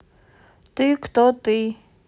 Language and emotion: Russian, neutral